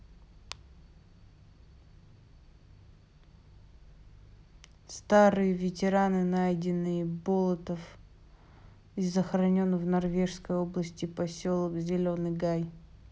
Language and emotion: Russian, neutral